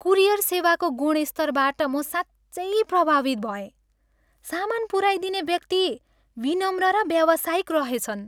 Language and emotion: Nepali, happy